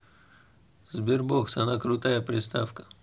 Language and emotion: Russian, neutral